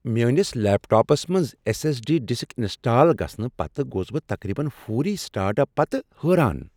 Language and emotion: Kashmiri, surprised